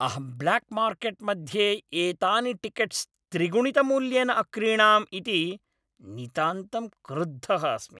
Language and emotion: Sanskrit, angry